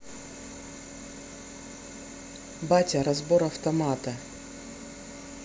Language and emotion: Russian, neutral